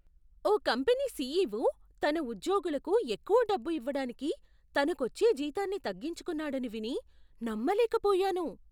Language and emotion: Telugu, surprised